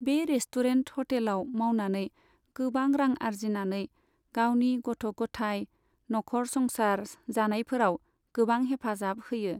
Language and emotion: Bodo, neutral